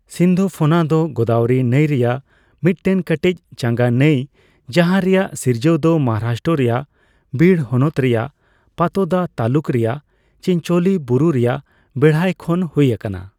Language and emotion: Santali, neutral